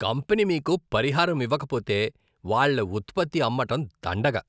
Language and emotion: Telugu, disgusted